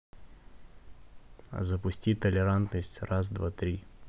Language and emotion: Russian, neutral